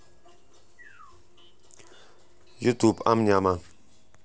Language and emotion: Russian, neutral